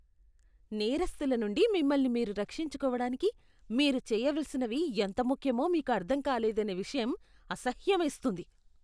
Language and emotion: Telugu, disgusted